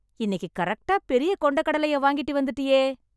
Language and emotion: Tamil, happy